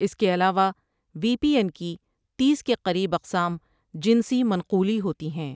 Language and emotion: Urdu, neutral